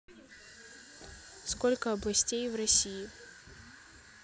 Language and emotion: Russian, neutral